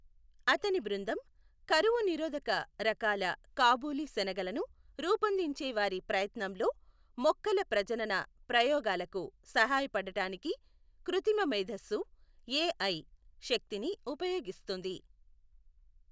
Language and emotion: Telugu, neutral